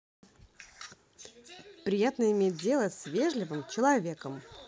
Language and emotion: Russian, positive